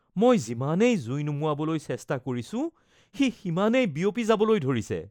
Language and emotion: Assamese, fearful